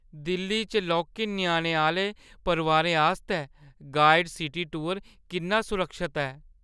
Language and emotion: Dogri, fearful